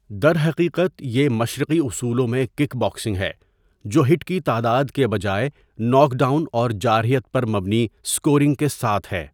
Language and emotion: Urdu, neutral